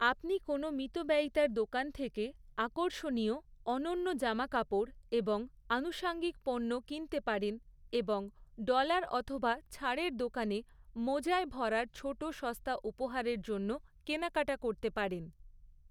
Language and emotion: Bengali, neutral